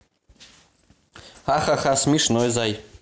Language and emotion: Russian, positive